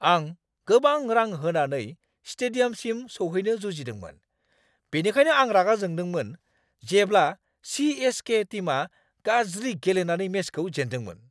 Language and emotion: Bodo, angry